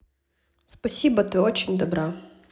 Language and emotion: Russian, positive